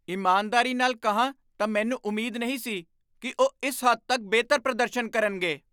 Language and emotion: Punjabi, surprised